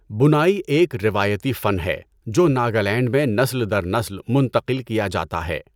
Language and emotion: Urdu, neutral